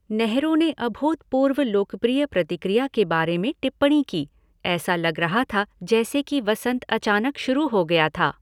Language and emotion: Hindi, neutral